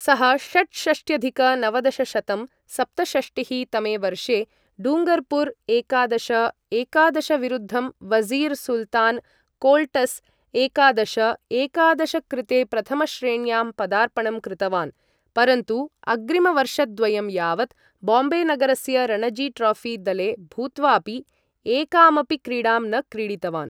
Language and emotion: Sanskrit, neutral